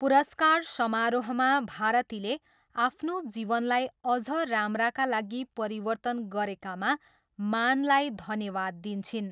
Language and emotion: Nepali, neutral